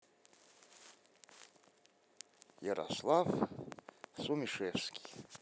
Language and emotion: Russian, neutral